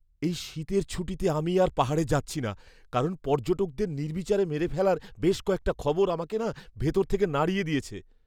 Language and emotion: Bengali, fearful